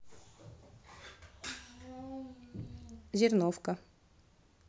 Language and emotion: Russian, neutral